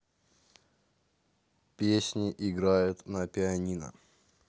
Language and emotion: Russian, neutral